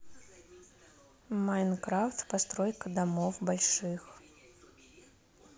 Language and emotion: Russian, neutral